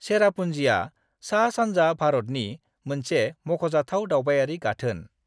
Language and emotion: Bodo, neutral